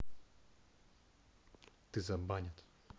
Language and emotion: Russian, angry